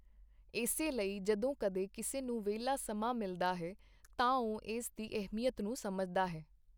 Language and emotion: Punjabi, neutral